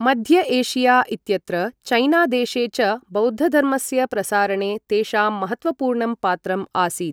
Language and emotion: Sanskrit, neutral